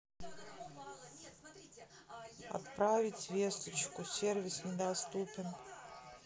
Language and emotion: Russian, sad